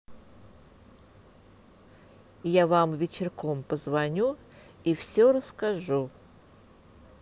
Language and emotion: Russian, neutral